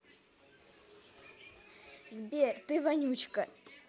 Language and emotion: Russian, positive